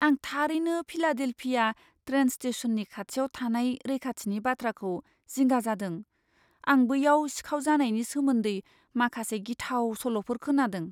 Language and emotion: Bodo, fearful